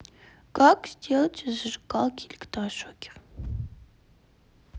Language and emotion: Russian, sad